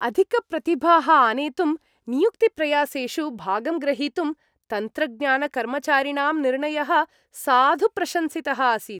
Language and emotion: Sanskrit, happy